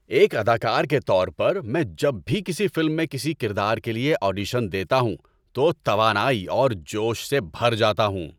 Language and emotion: Urdu, happy